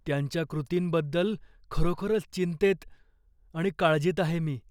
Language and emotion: Marathi, fearful